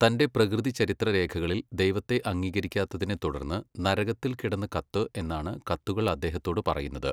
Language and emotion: Malayalam, neutral